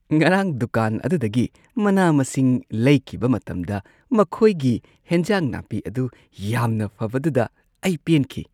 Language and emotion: Manipuri, happy